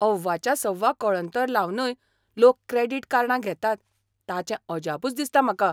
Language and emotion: Goan Konkani, surprised